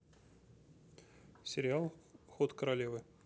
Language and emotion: Russian, neutral